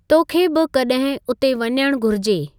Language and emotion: Sindhi, neutral